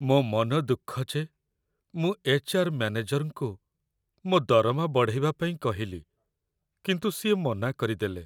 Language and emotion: Odia, sad